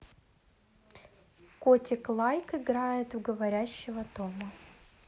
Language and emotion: Russian, neutral